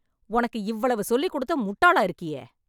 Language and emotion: Tamil, angry